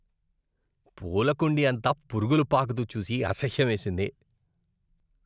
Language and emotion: Telugu, disgusted